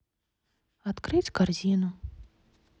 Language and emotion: Russian, sad